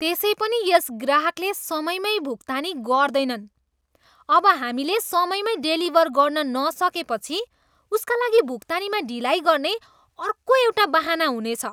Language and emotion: Nepali, disgusted